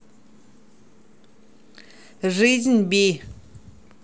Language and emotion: Russian, neutral